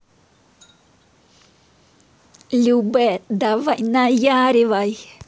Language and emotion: Russian, positive